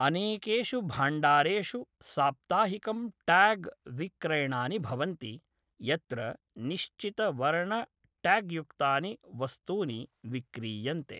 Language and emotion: Sanskrit, neutral